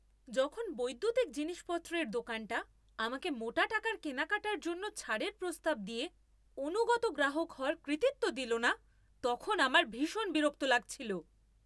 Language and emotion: Bengali, angry